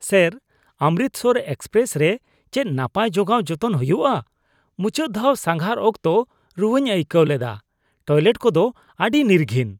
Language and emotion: Santali, disgusted